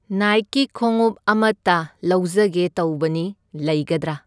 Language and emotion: Manipuri, neutral